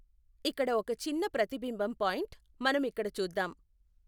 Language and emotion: Telugu, neutral